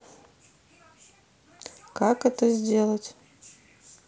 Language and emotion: Russian, sad